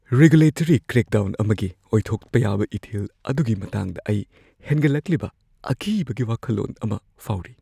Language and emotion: Manipuri, fearful